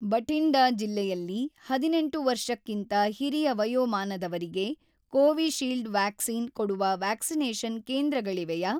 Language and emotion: Kannada, neutral